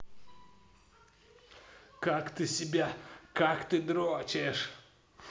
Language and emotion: Russian, angry